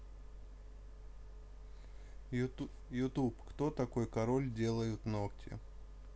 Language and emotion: Russian, neutral